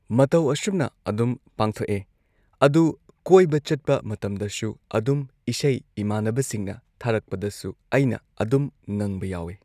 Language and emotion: Manipuri, neutral